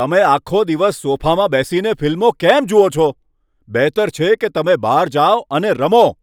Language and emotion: Gujarati, angry